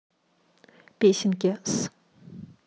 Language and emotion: Russian, neutral